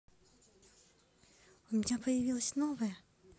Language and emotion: Russian, neutral